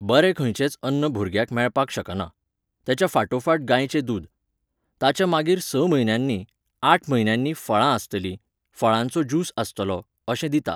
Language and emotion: Goan Konkani, neutral